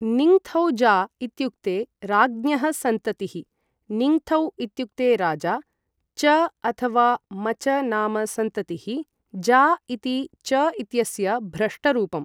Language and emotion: Sanskrit, neutral